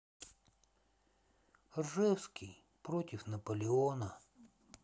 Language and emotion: Russian, sad